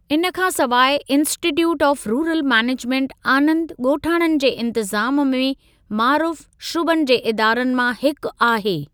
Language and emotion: Sindhi, neutral